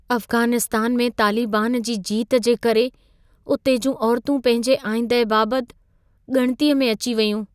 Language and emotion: Sindhi, fearful